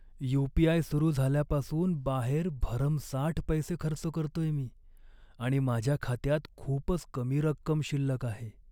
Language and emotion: Marathi, sad